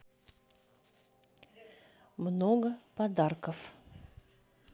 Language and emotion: Russian, neutral